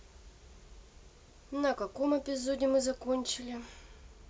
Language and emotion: Russian, neutral